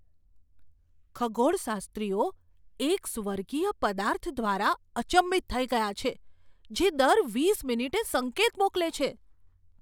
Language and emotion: Gujarati, surprised